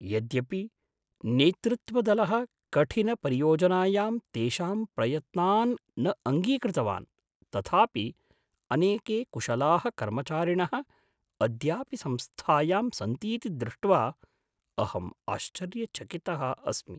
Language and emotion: Sanskrit, surprised